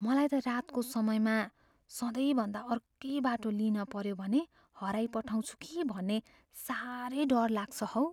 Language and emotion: Nepali, fearful